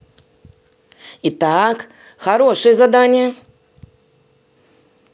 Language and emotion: Russian, positive